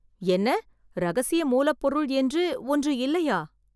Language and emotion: Tamil, surprised